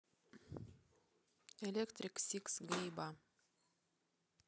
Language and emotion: Russian, neutral